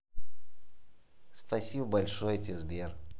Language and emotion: Russian, positive